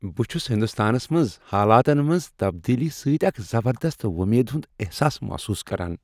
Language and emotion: Kashmiri, happy